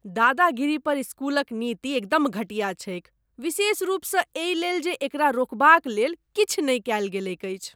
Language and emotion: Maithili, disgusted